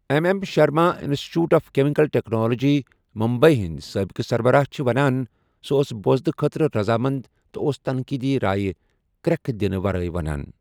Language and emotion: Kashmiri, neutral